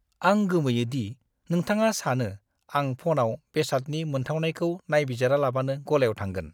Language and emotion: Bodo, disgusted